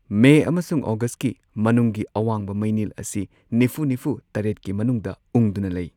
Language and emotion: Manipuri, neutral